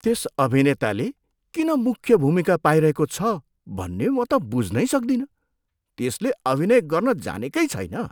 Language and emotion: Nepali, disgusted